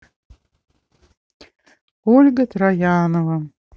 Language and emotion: Russian, sad